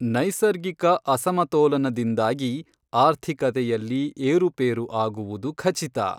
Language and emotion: Kannada, neutral